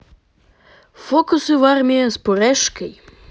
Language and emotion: Russian, positive